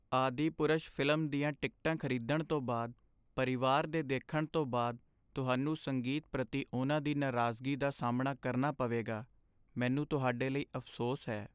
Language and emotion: Punjabi, sad